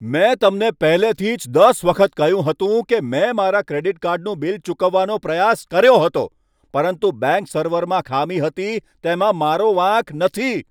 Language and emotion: Gujarati, angry